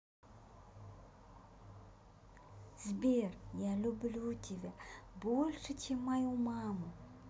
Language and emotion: Russian, positive